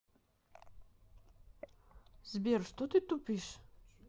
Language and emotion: Russian, neutral